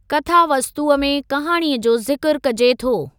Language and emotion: Sindhi, neutral